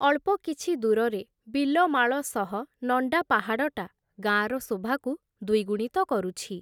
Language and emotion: Odia, neutral